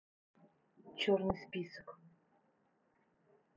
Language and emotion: Russian, neutral